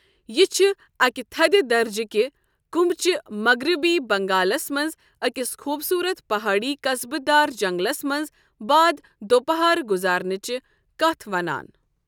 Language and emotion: Kashmiri, neutral